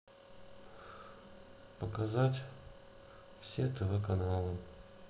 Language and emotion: Russian, sad